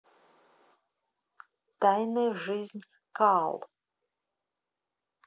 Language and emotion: Russian, neutral